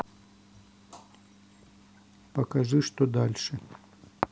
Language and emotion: Russian, neutral